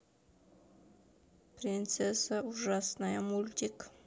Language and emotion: Russian, sad